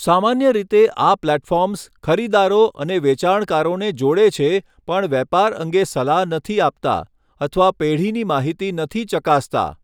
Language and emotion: Gujarati, neutral